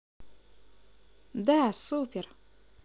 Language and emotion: Russian, positive